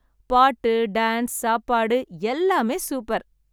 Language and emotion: Tamil, happy